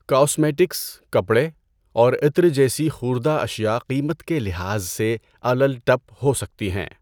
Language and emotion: Urdu, neutral